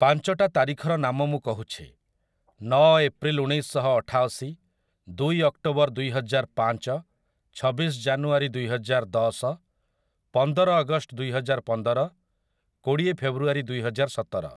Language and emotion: Odia, neutral